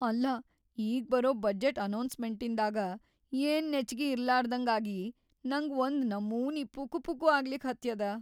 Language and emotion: Kannada, fearful